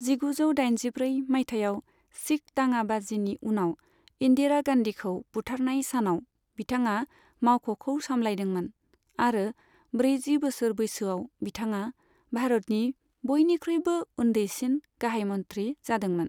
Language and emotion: Bodo, neutral